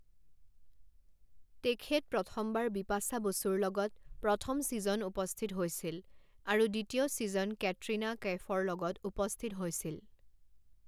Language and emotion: Assamese, neutral